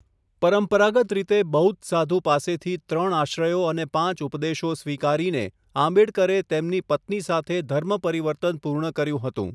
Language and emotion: Gujarati, neutral